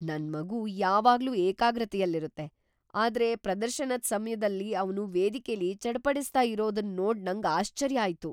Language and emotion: Kannada, surprised